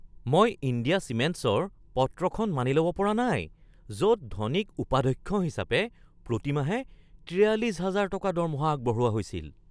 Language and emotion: Assamese, surprised